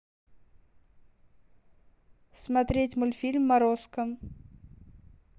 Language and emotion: Russian, neutral